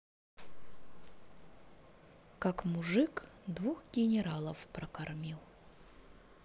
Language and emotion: Russian, neutral